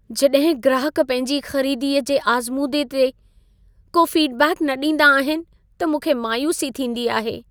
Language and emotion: Sindhi, sad